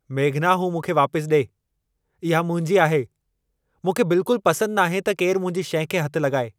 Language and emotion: Sindhi, angry